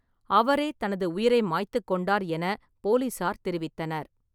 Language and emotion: Tamil, neutral